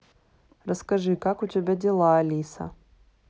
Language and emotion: Russian, neutral